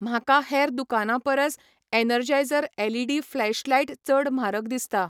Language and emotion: Goan Konkani, neutral